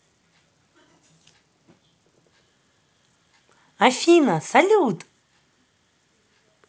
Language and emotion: Russian, positive